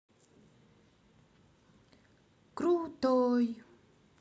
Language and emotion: Russian, neutral